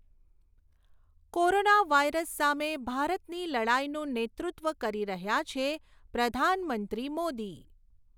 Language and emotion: Gujarati, neutral